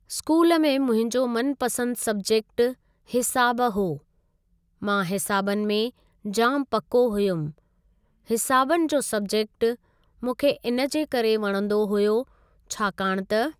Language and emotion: Sindhi, neutral